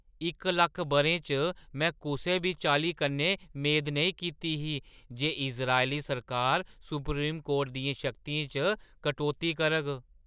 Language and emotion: Dogri, surprised